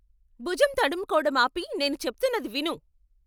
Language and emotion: Telugu, angry